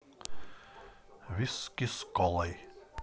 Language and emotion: Russian, neutral